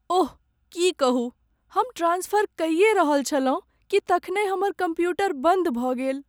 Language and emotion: Maithili, sad